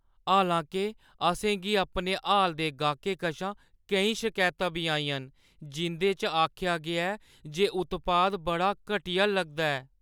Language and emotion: Dogri, sad